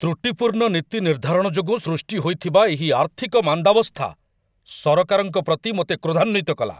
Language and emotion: Odia, angry